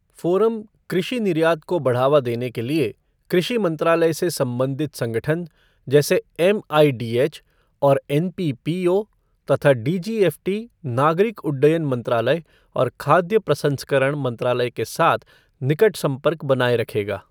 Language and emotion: Hindi, neutral